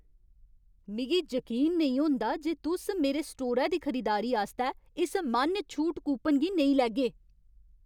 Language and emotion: Dogri, angry